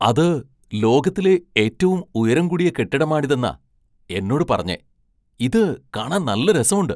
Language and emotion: Malayalam, surprised